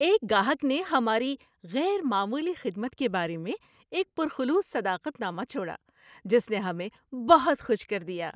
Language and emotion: Urdu, happy